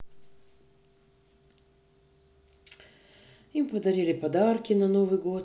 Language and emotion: Russian, sad